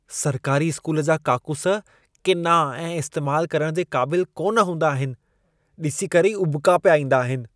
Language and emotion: Sindhi, disgusted